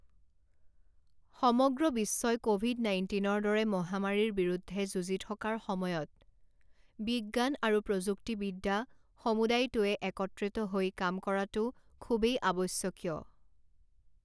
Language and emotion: Assamese, neutral